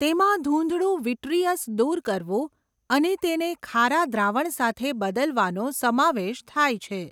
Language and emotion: Gujarati, neutral